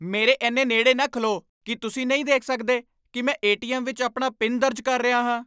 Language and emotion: Punjabi, angry